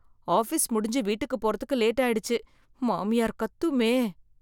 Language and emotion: Tamil, fearful